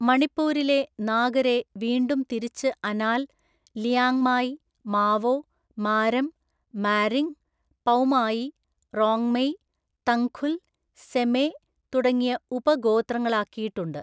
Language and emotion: Malayalam, neutral